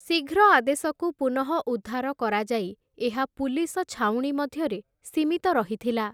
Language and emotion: Odia, neutral